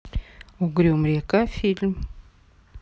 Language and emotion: Russian, neutral